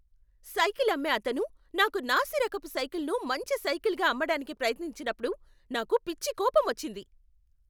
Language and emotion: Telugu, angry